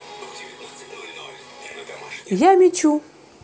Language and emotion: Russian, positive